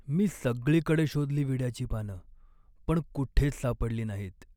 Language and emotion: Marathi, sad